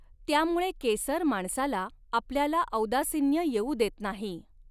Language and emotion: Marathi, neutral